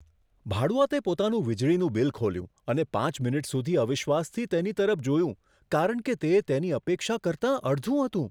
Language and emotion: Gujarati, surprised